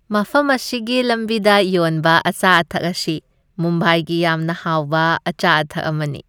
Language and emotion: Manipuri, happy